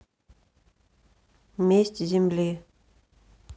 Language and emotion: Russian, neutral